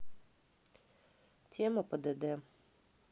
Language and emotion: Russian, neutral